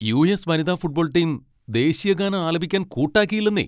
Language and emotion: Malayalam, angry